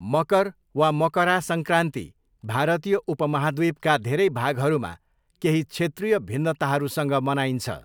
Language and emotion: Nepali, neutral